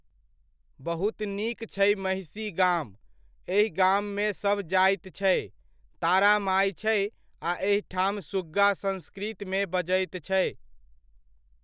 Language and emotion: Maithili, neutral